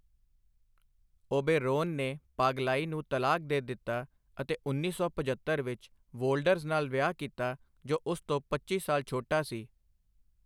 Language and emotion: Punjabi, neutral